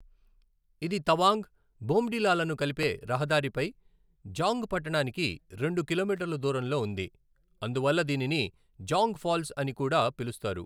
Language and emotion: Telugu, neutral